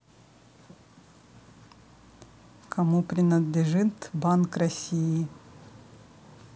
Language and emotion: Russian, neutral